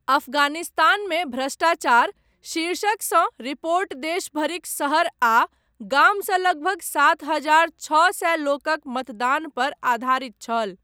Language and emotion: Maithili, neutral